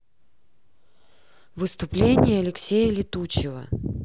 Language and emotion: Russian, neutral